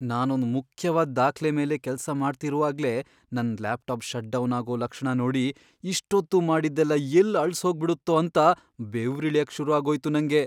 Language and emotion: Kannada, fearful